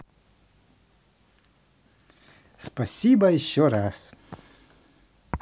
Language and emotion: Russian, positive